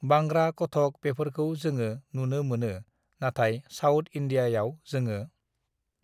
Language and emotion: Bodo, neutral